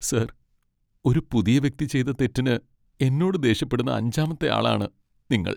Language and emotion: Malayalam, sad